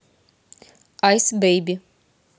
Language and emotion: Russian, neutral